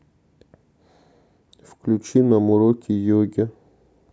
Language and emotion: Russian, neutral